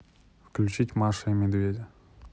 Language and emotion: Russian, neutral